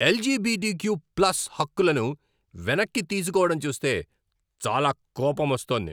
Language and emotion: Telugu, angry